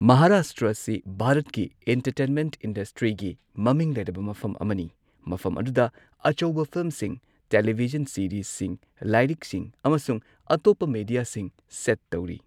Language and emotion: Manipuri, neutral